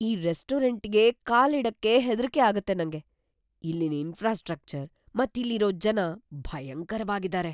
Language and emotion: Kannada, fearful